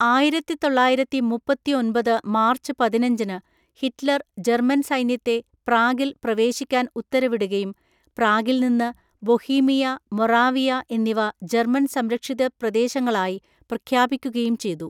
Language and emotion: Malayalam, neutral